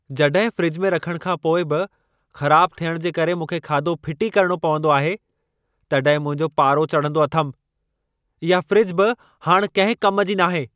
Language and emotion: Sindhi, angry